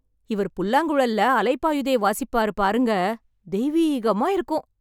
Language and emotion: Tamil, happy